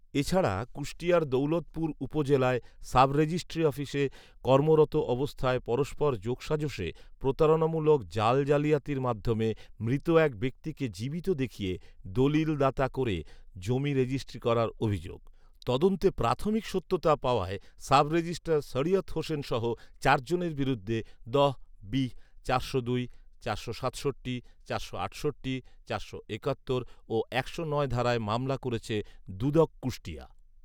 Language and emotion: Bengali, neutral